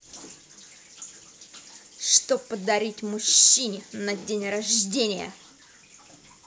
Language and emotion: Russian, angry